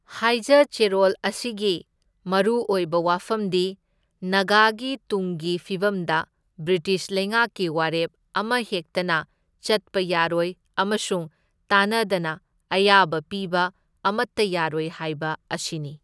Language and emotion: Manipuri, neutral